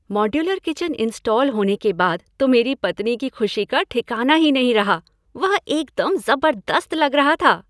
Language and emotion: Hindi, happy